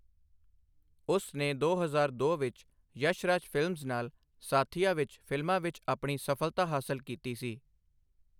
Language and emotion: Punjabi, neutral